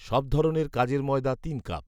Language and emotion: Bengali, neutral